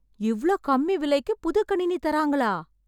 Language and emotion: Tamil, surprised